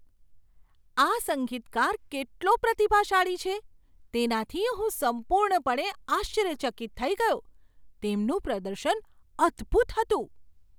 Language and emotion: Gujarati, surprised